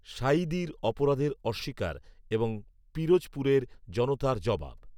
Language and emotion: Bengali, neutral